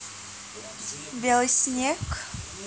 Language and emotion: Russian, neutral